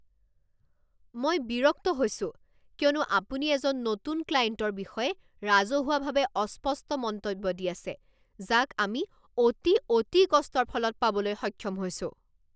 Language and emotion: Assamese, angry